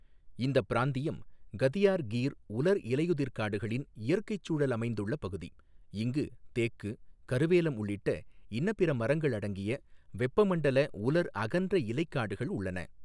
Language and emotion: Tamil, neutral